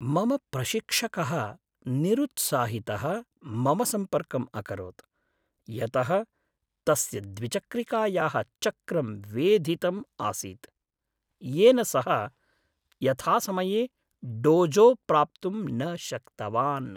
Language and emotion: Sanskrit, sad